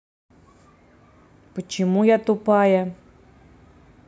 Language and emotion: Russian, neutral